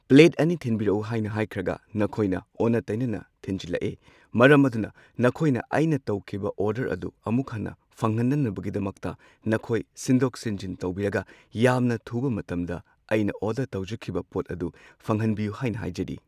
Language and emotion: Manipuri, neutral